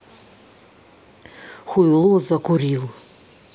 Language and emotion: Russian, angry